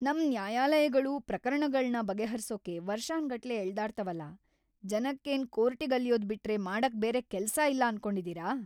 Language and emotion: Kannada, angry